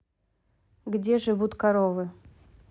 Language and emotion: Russian, neutral